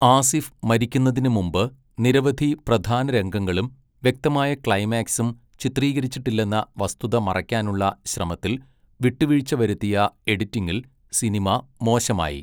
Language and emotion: Malayalam, neutral